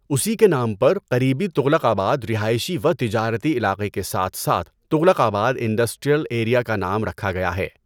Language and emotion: Urdu, neutral